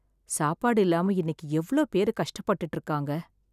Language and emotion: Tamil, sad